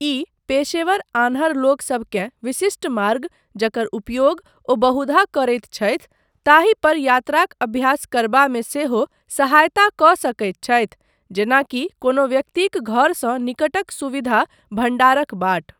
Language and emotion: Maithili, neutral